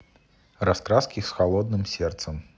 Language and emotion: Russian, neutral